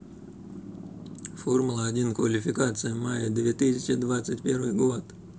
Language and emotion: Russian, neutral